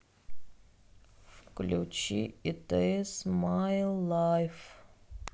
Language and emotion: Russian, sad